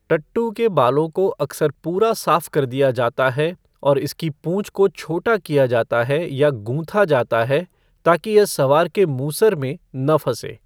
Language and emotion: Hindi, neutral